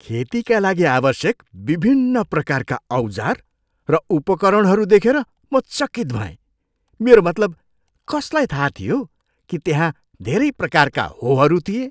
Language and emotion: Nepali, surprised